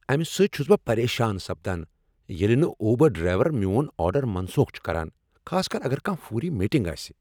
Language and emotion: Kashmiri, angry